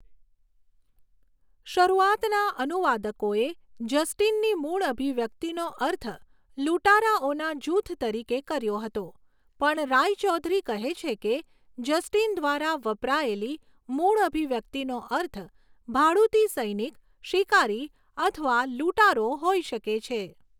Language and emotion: Gujarati, neutral